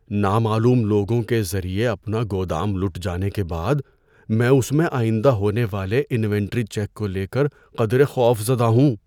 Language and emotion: Urdu, fearful